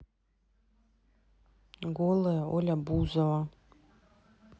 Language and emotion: Russian, neutral